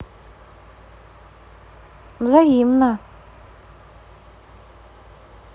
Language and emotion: Russian, neutral